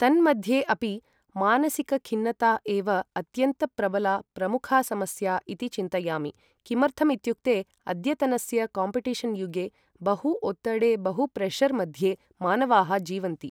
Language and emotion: Sanskrit, neutral